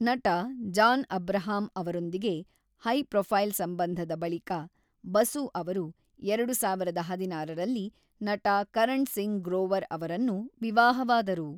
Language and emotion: Kannada, neutral